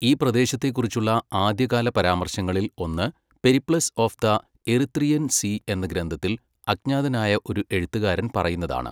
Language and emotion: Malayalam, neutral